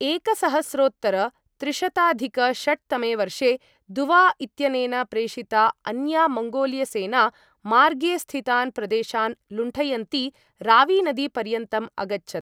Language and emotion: Sanskrit, neutral